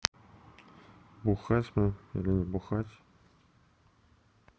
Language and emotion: Russian, sad